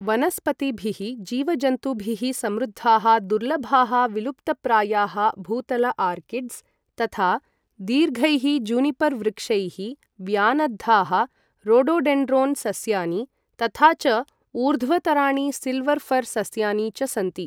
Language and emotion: Sanskrit, neutral